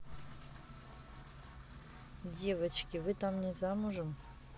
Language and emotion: Russian, neutral